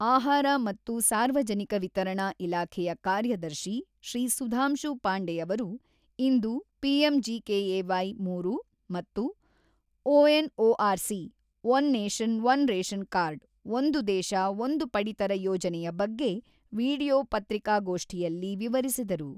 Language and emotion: Kannada, neutral